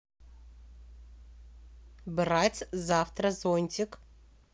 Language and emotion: Russian, neutral